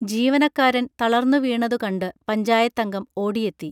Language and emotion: Malayalam, neutral